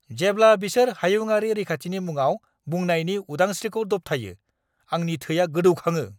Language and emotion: Bodo, angry